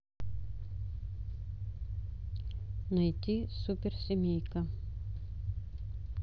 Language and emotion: Russian, neutral